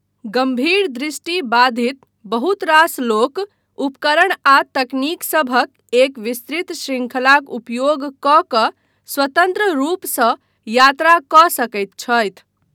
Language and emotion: Maithili, neutral